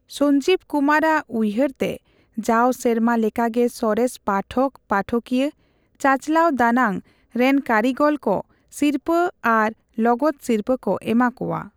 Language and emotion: Santali, neutral